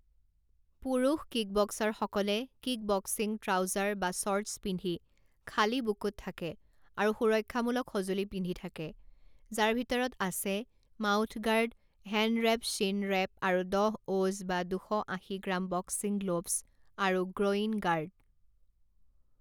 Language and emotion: Assamese, neutral